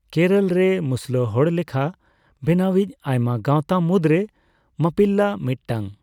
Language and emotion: Santali, neutral